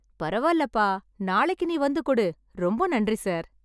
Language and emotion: Tamil, happy